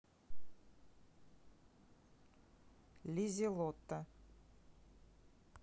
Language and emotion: Russian, neutral